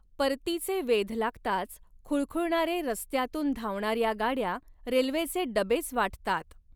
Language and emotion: Marathi, neutral